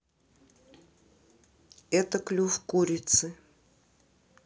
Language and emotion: Russian, neutral